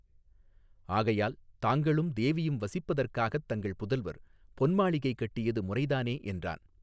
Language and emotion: Tamil, neutral